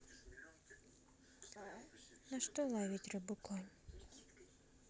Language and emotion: Russian, sad